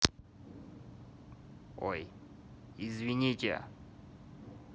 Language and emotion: Russian, neutral